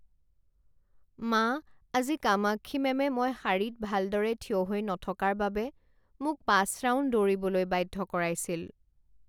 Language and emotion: Assamese, sad